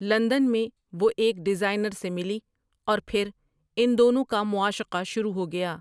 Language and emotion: Urdu, neutral